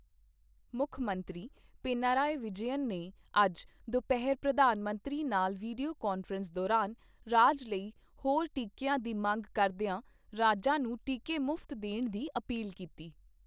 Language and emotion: Punjabi, neutral